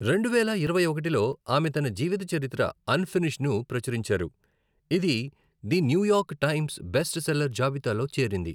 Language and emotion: Telugu, neutral